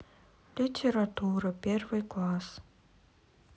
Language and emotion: Russian, sad